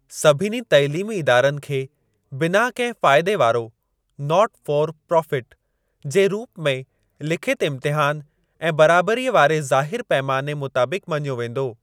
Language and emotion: Sindhi, neutral